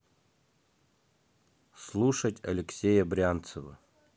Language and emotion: Russian, neutral